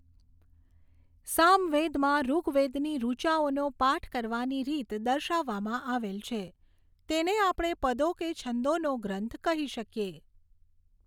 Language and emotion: Gujarati, neutral